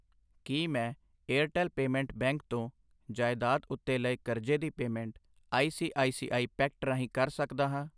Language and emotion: Punjabi, neutral